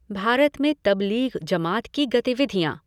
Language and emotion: Hindi, neutral